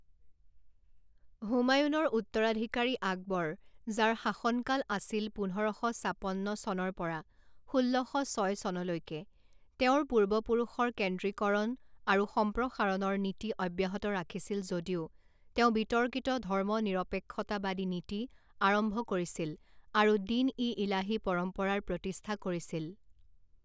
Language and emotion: Assamese, neutral